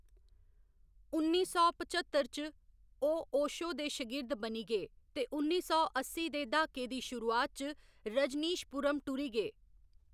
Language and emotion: Dogri, neutral